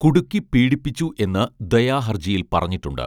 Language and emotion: Malayalam, neutral